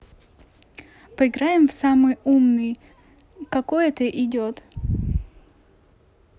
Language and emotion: Russian, neutral